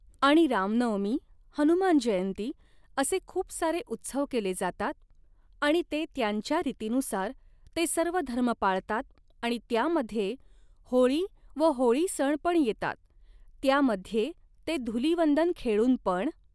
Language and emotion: Marathi, neutral